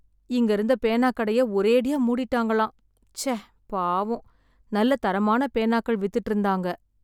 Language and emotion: Tamil, sad